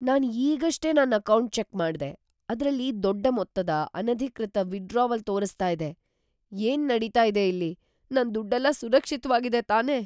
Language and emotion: Kannada, fearful